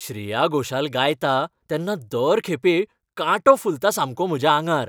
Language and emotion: Goan Konkani, happy